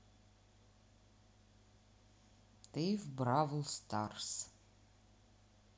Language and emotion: Russian, neutral